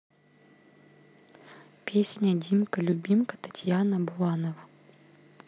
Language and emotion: Russian, neutral